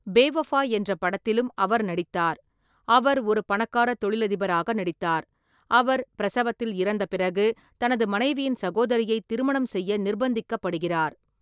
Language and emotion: Tamil, neutral